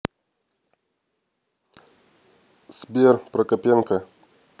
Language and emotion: Russian, neutral